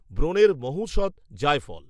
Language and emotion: Bengali, neutral